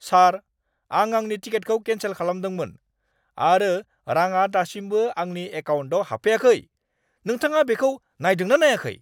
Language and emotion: Bodo, angry